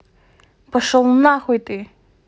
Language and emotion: Russian, angry